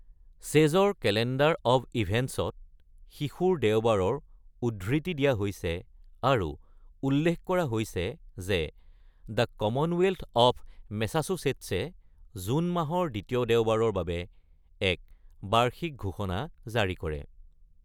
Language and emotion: Assamese, neutral